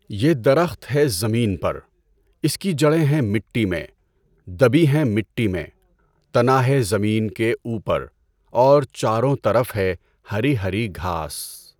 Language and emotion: Urdu, neutral